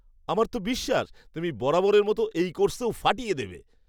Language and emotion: Bengali, happy